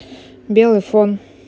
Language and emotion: Russian, neutral